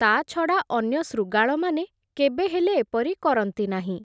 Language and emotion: Odia, neutral